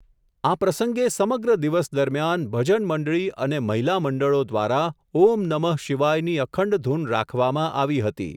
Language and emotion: Gujarati, neutral